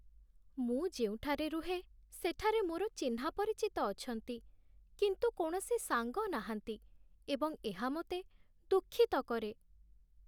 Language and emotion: Odia, sad